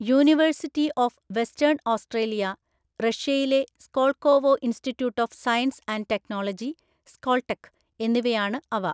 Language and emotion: Malayalam, neutral